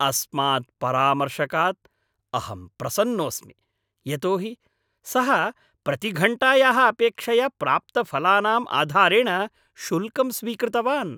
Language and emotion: Sanskrit, happy